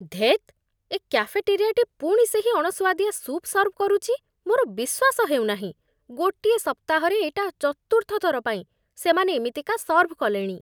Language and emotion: Odia, disgusted